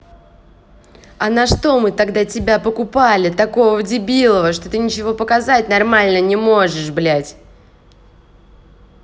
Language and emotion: Russian, angry